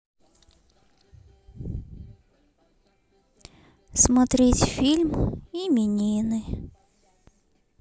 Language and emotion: Russian, sad